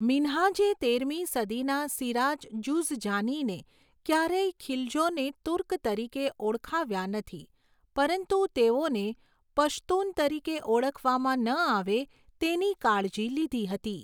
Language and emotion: Gujarati, neutral